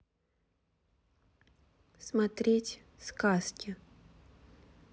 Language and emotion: Russian, neutral